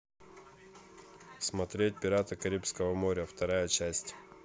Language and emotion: Russian, neutral